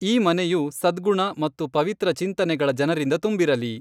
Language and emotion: Kannada, neutral